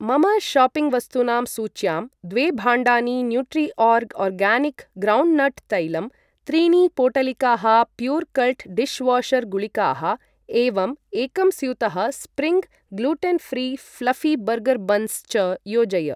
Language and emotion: Sanskrit, neutral